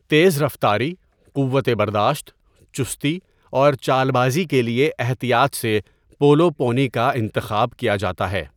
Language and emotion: Urdu, neutral